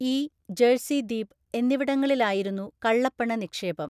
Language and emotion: Malayalam, neutral